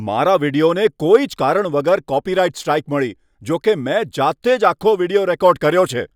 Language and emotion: Gujarati, angry